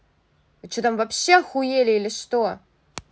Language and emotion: Russian, angry